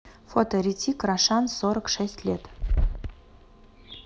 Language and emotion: Russian, neutral